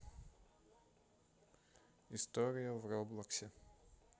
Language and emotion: Russian, neutral